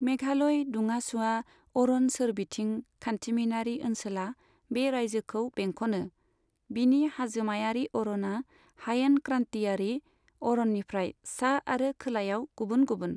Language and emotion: Bodo, neutral